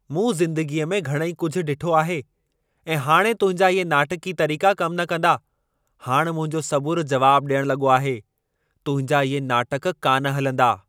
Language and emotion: Sindhi, angry